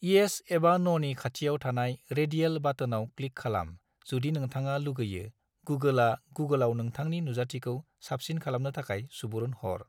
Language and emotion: Bodo, neutral